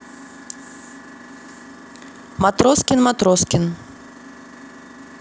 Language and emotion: Russian, neutral